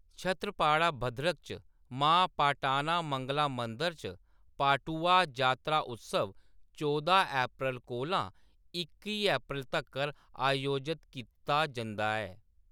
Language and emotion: Dogri, neutral